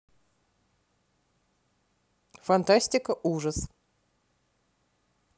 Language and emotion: Russian, neutral